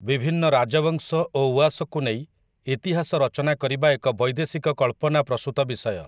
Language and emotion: Odia, neutral